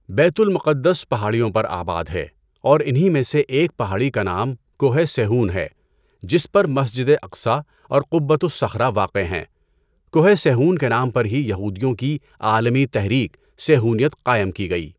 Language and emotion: Urdu, neutral